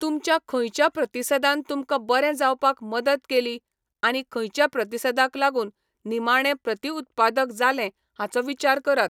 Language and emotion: Goan Konkani, neutral